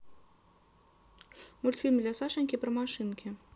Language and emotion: Russian, neutral